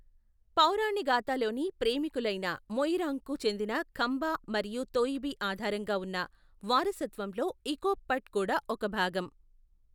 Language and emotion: Telugu, neutral